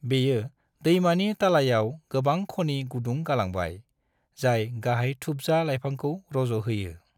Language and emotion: Bodo, neutral